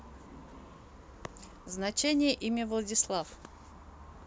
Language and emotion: Russian, neutral